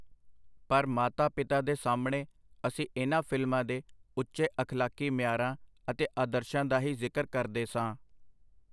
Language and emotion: Punjabi, neutral